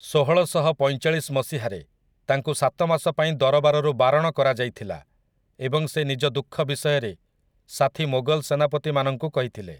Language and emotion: Odia, neutral